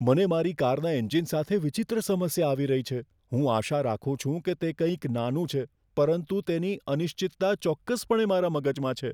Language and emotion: Gujarati, fearful